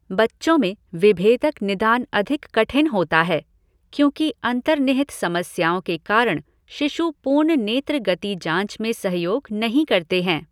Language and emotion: Hindi, neutral